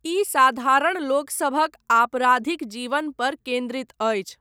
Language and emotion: Maithili, neutral